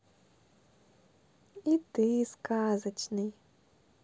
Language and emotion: Russian, positive